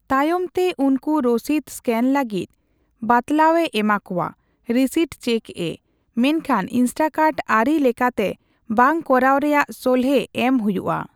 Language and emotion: Santali, neutral